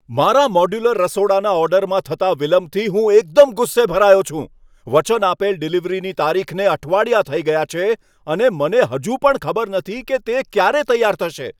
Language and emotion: Gujarati, angry